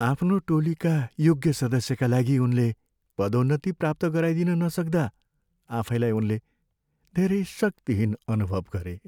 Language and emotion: Nepali, sad